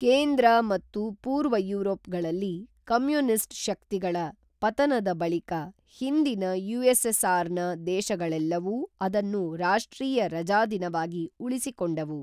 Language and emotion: Kannada, neutral